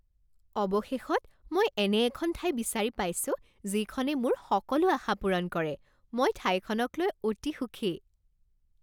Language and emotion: Assamese, happy